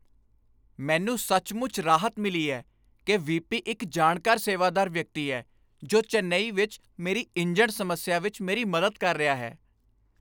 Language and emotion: Punjabi, happy